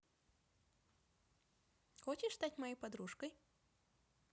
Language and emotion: Russian, positive